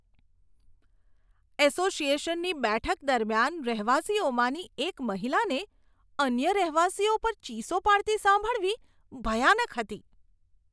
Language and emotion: Gujarati, disgusted